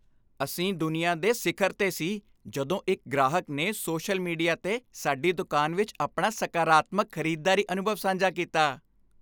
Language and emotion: Punjabi, happy